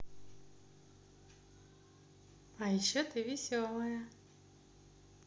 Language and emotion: Russian, positive